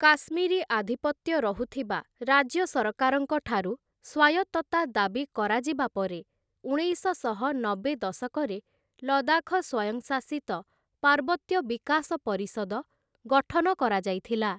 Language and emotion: Odia, neutral